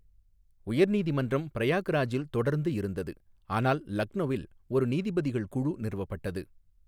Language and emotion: Tamil, neutral